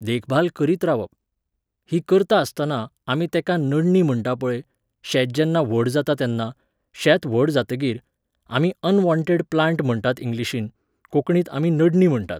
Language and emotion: Goan Konkani, neutral